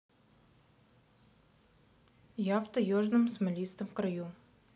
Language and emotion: Russian, neutral